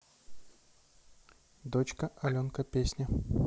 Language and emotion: Russian, neutral